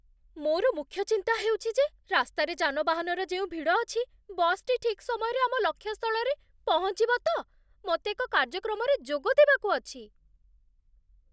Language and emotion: Odia, fearful